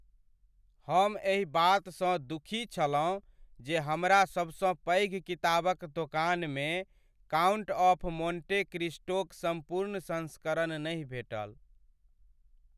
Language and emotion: Maithili, sad